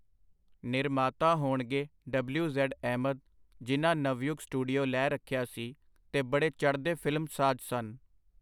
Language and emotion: Punjabi, neutral